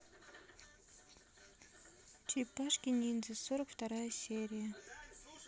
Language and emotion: Russian, neutral